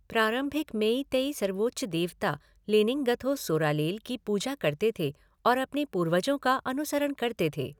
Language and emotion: Hindi, neutral